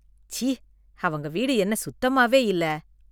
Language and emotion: Tamil, disgusted